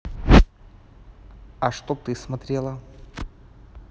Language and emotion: Russian, neutral